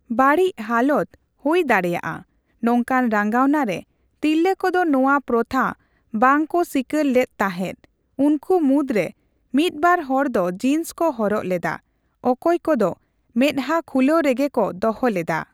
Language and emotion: Santali, neutral